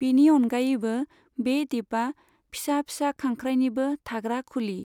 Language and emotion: Bodo, neutral